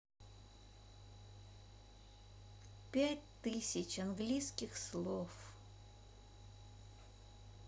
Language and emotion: Russian, sad